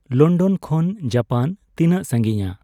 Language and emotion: Santali, neutral